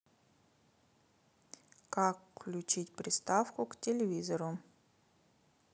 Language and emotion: Russian, neutral